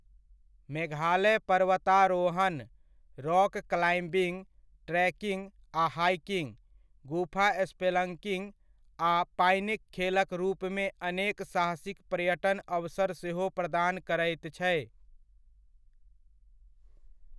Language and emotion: Maithili, neutral